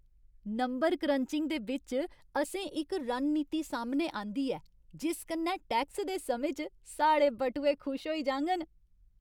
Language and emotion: Dogri, happy